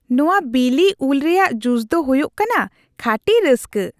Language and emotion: Santali, happy